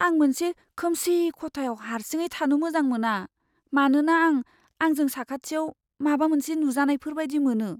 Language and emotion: Bodo, fearful